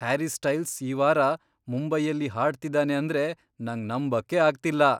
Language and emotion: Kannada, surprised